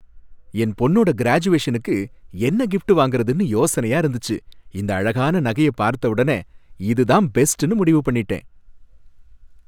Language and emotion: Tamil, happy